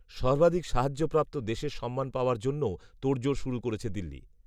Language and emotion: Bengali, neutral